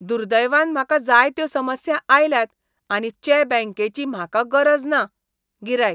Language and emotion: Goan Konkani, disgusted